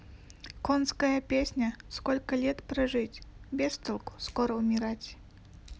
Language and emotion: Russian, sad